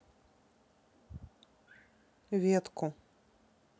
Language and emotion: Russian, neutral